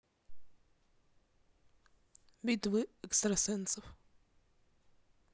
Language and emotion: Russian, neutral